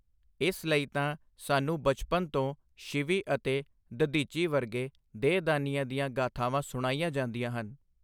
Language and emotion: Punjabi, neutral